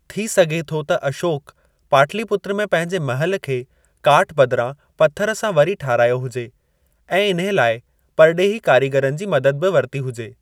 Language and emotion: Sindhi, neutral